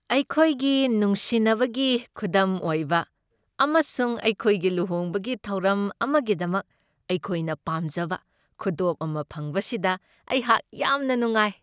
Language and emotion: Manipuri, happy